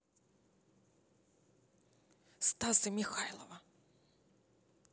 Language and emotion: Russian, neutral